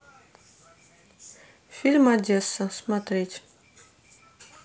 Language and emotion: Russian, neutral